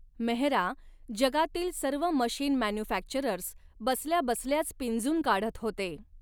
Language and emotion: Marathi, neutral